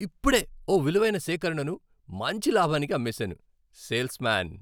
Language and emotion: Telugu, happy